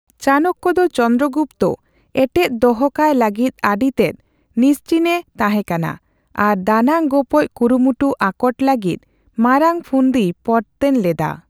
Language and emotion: Santali, neutral